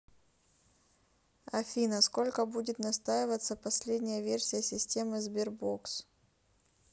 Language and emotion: Russian, neutral